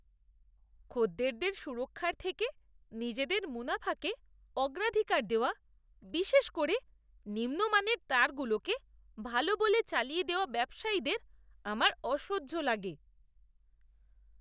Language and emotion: Bengali, disgusted